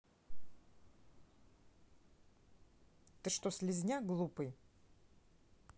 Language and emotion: Russian, angry